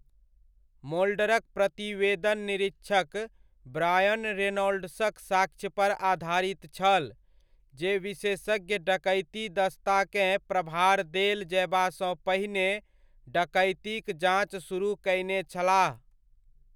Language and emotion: Maithili, neutral